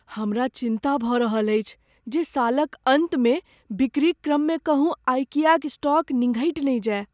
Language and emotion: Maithili, fearful